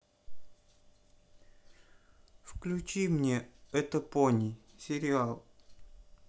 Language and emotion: Russian, sad